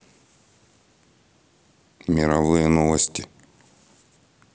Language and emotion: Russian, neutral